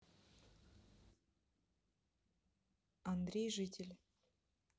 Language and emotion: Russian, neutral